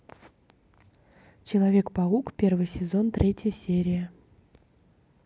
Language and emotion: Russian, neutral